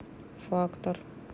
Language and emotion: Russian, neutral